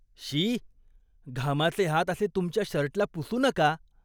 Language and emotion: Marathi, disgusted